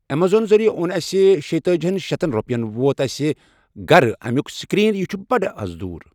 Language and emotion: Kashmiri, neutral